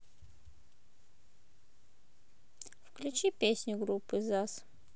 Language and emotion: Russian, neutral